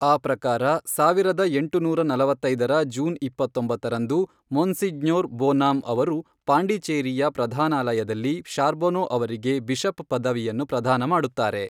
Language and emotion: Kannada, neutral